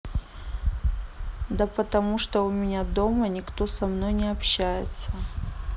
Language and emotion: Russian, neutral